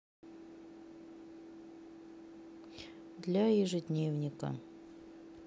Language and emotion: Russian, sad